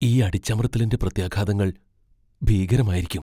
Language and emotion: Malayalam, fearful